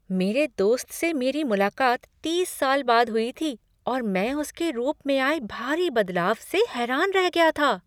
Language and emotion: Hindi, surprised